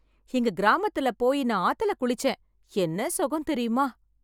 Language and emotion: Tamil, happy